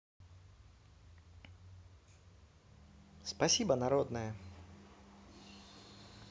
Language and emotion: Russian, neutral